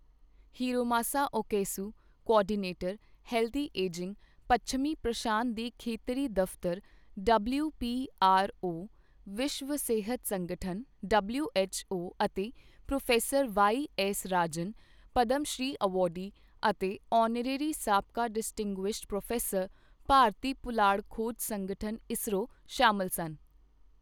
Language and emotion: Punjabi, neutral